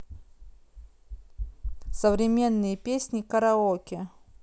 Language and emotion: Russian, neutral